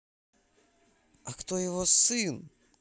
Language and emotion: Russian, angry